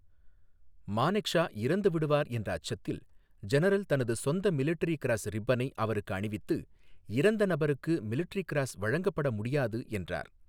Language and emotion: Tamil, neutral